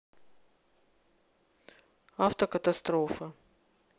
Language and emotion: Russian, neutral